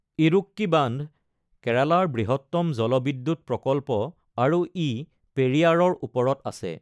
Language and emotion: Assamese, neutral